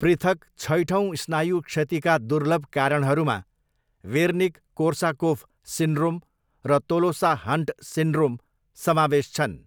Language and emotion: Nepali, neutral